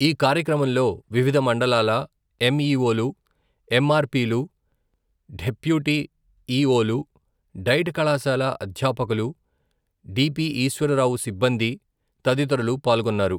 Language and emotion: Telugu, neutral